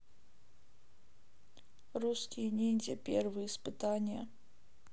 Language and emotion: Russian, sad